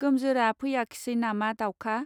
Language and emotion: Bodo, neutral